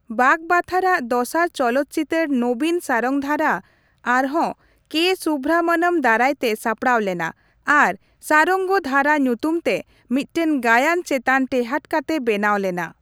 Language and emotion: Santali, neutral